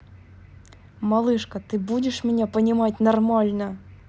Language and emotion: Russian, angry